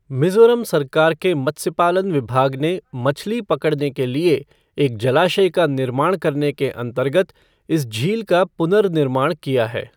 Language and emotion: Hindi, neutral